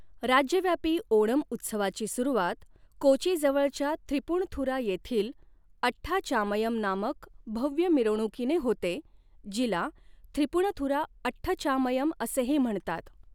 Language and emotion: Marathi, neutral